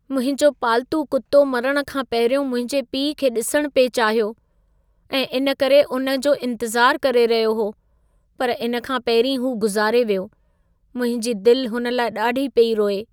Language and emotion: Sindhi, sad